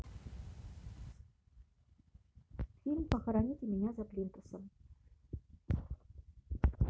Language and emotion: Russian, neutral